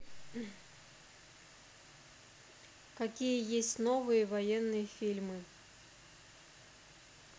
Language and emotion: Russian, neutral